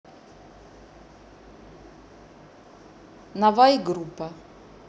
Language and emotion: Russian, neutral